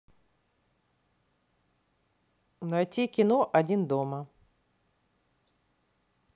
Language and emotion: Russian, neutral